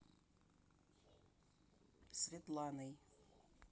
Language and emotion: Russian, neutral